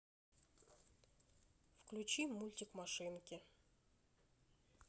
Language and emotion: Russian, neutral